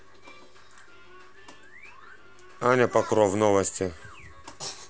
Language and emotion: Russian, neutral